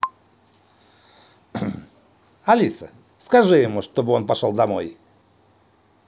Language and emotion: Russian, positive